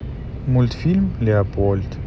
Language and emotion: Russian, neutral